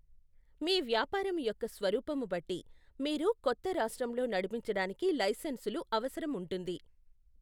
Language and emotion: Telugu, neutral